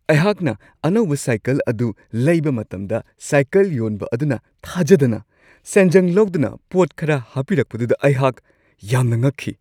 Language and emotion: Manipuri, surprised